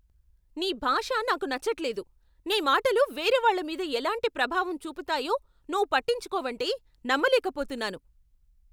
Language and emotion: Telugu, angry